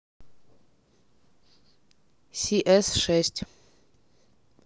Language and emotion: Russian, neutral